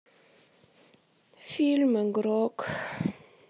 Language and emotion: Russian, sad